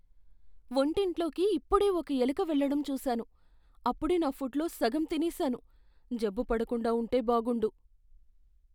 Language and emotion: Telugu, fearful